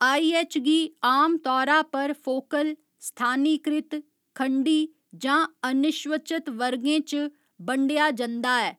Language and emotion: Dogri, neutral